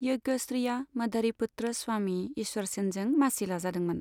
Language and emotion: Bodo, neutral